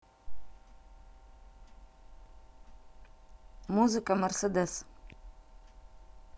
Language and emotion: Russian, neutral